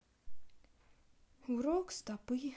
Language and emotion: Russian, sad